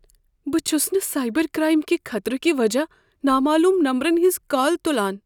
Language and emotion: Kashmiri, fearful